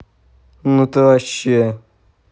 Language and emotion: Russian, angry